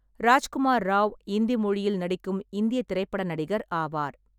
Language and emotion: Tamil, neutral